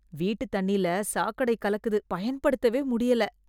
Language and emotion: Tamil, disgusted